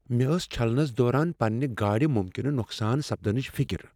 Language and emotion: Kashmiri, fearful